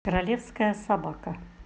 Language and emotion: Russian, neutral